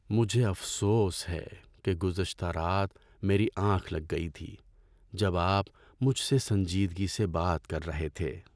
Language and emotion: Urdu, sad